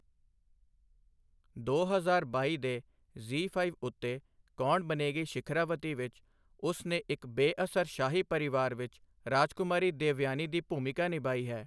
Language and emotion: Punjabi, neutral